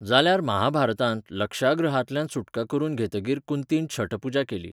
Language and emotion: Goan Konkani, neutral